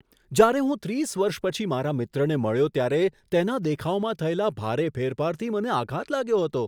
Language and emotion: Gujarati, surprised